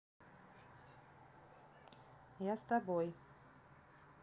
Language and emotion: Russian, neutral